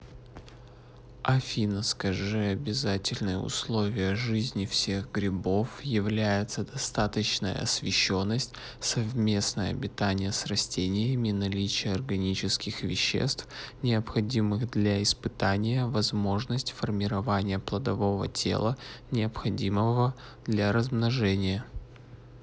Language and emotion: Russian, neutral